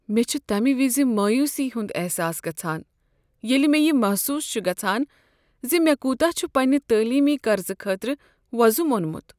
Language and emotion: Kashmiri, sad